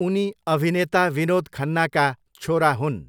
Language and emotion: Nepali, neutral